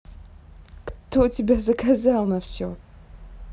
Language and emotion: Russian, neutral